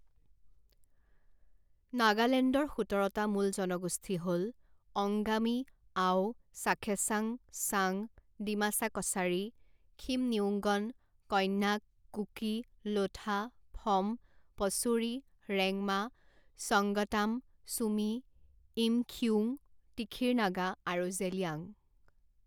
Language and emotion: Assamese, neutral